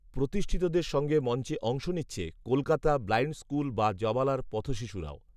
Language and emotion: Bengali, neutral